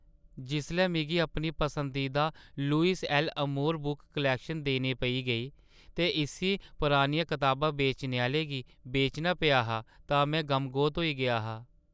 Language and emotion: Dogri, sad